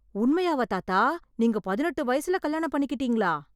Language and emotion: Tamil, surprised